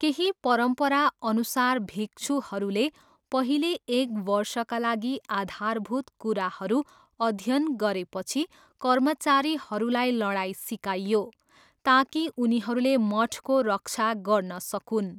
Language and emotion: Nepali, neutral